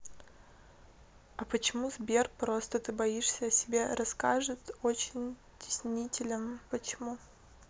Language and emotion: Russian, neutral